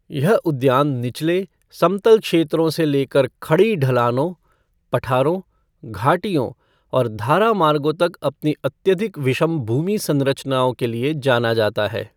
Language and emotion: Hindi, neutral